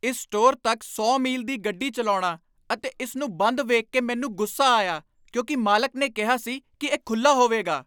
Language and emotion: Punjabi, angry